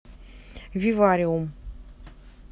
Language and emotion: Russian, neutral